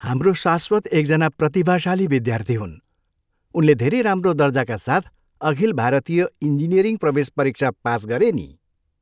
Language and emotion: Nepali, happy